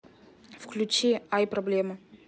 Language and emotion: Russian, neutral